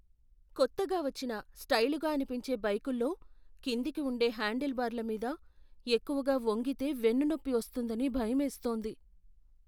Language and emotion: Telugu, fearful